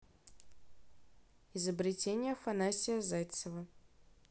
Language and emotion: Russian, neutral